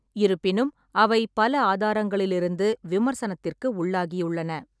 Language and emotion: Tamil, neutral